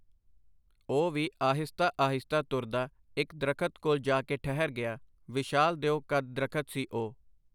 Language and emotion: Punjabi, neutral